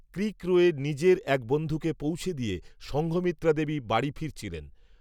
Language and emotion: Bengali, neutral